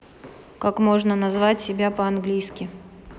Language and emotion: Russian, neutral